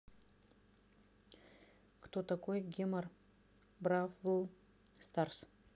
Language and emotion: Russian, neutral